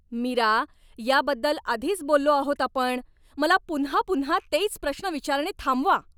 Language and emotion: Marathi, angry